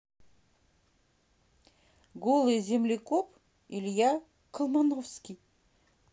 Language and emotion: Russian, neutral